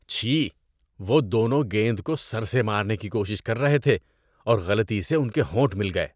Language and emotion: Urdu, disgusted